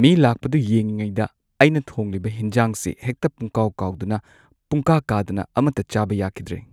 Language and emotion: Manipuri, neutral